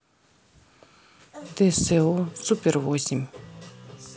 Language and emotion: Russian, neutral